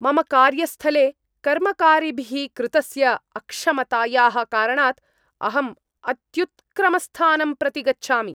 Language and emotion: Sanskrit, angry